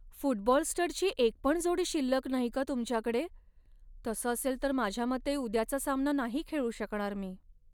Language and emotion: Marathi, sad